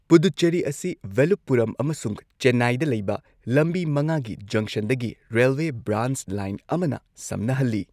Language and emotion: Manipuri, neutral